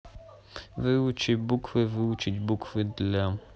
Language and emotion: Russian, neutral